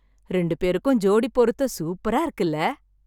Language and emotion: Tamil, happy